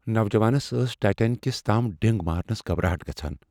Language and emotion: Kashmiri, fearful